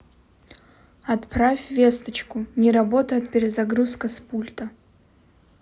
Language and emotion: Russian, neutral